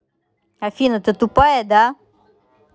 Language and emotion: Russian, angry